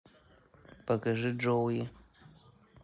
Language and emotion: Russian, neutral